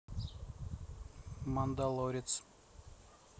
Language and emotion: Russian, neutral